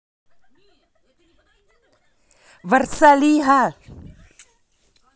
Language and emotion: Russian, angry